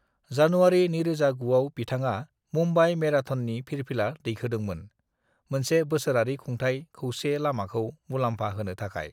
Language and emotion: Bodo, neutral